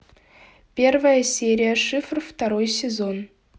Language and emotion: Russian, neutral